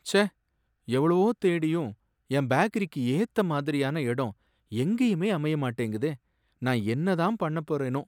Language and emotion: Tamil, sad